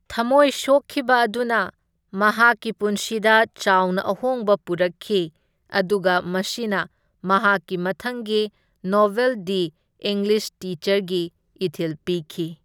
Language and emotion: Manipuri, neutral